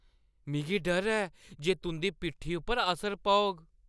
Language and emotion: Dogri, fearful